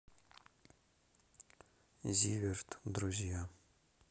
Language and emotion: Russian, neutral